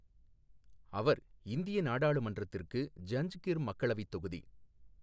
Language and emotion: Tamil, neutral